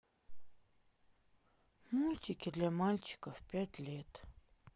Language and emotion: Russian, sad